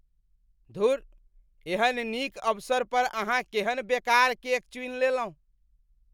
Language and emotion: Maithili, disgusted